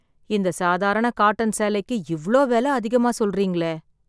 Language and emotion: Tamil, sad